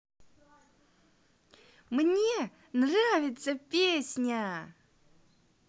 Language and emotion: Russian, positive